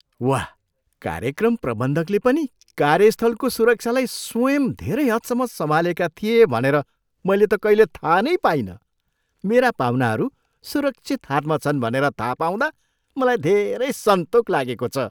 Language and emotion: Nepali, surprised